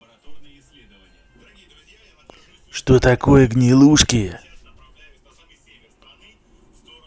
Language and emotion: Russian, neutral